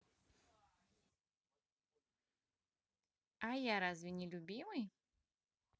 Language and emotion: Russian, positive